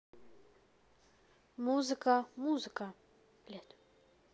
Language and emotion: Russian, neutral